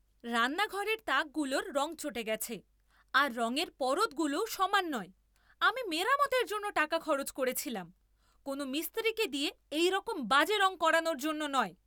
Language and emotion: Bengali, angry